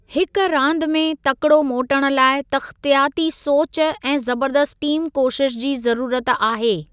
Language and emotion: Sindhi, neutral